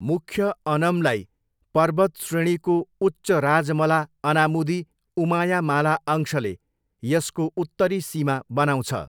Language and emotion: Nepali, neutral